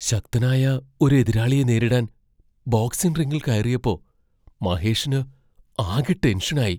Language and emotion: Malayalam, fearful